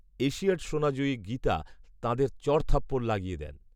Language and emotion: Bengali, neutral